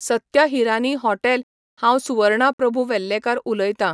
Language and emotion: Goan Konkani, neutral